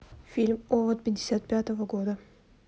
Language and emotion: Russian, neutral